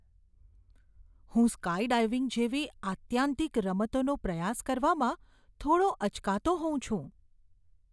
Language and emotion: Gujarati, fearful